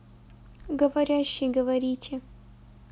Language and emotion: Russian, neutral